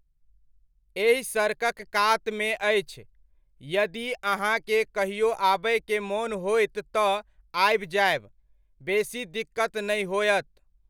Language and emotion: Maithili, neutral